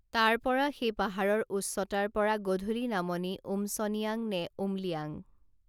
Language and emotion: Assamese, neutral